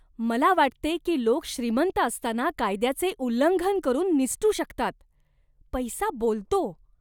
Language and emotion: Marathi, disgusted